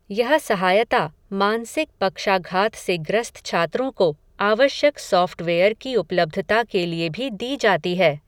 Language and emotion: Hindi, neutral